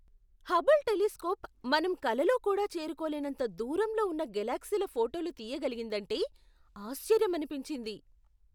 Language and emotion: Telugu, surprised